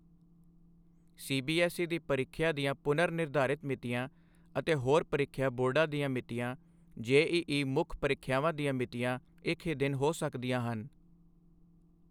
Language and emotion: Punjabi, neutral